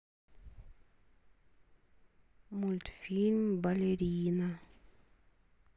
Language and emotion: Russian, sad